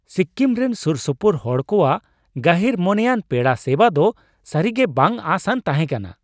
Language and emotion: Santali, surprised